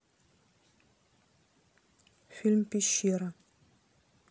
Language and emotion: Russian, neutral